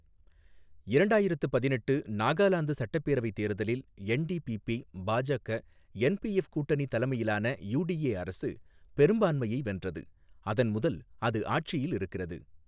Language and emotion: Tamil, neutral